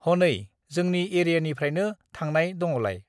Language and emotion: Bodo, neutral